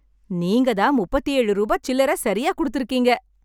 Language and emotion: Tamil, happy